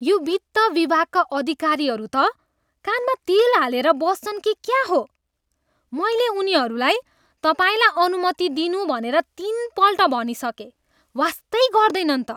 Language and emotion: Nepali, disgusted